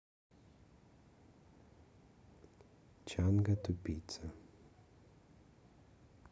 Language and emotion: Russian, neutral